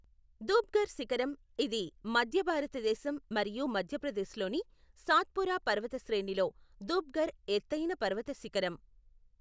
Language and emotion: Telugu, neutral